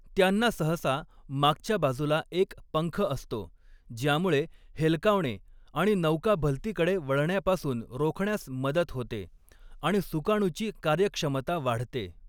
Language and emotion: Marathi, neutral